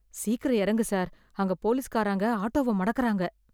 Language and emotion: Tamil, fearful